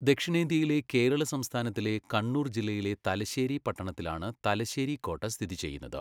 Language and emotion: Malayalam, neutral